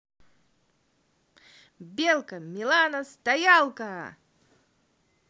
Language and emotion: Russian, positive